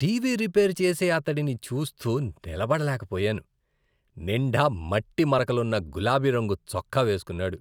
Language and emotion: Telugu, disgusted